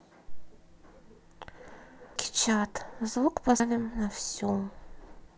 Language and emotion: Russian, neutral